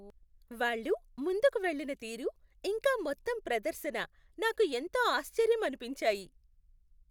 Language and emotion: Telugu, happy